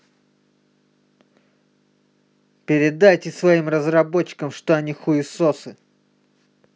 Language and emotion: Russian, angry